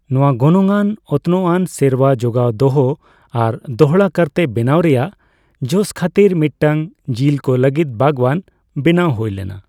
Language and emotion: Santali, neutral